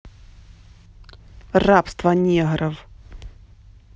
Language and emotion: Russian, angry